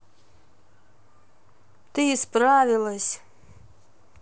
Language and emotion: Russian, positive